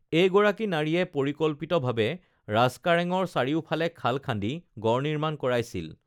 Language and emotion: Assamese, neutral